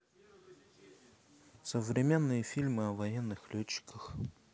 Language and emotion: Russian, neutral